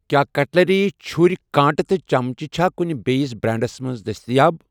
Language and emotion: Kashmiri, neutral